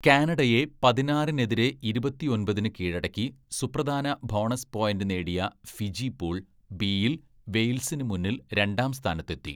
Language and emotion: Malayalam, neutral